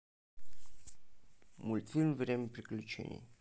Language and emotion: Russian, neutral